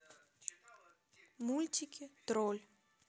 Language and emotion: Russian, neutral